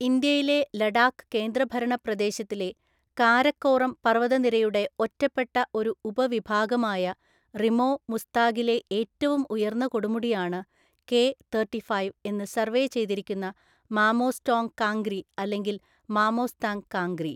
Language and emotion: Malayalam, neutral